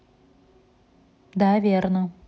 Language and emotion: Russian, neutral